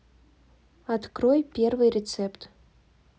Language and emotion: Russian, neutral